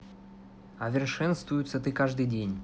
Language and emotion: Russian, neutral